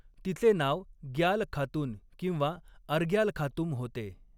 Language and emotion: Marathi, neutral